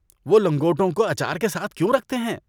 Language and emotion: Urdu, disgusted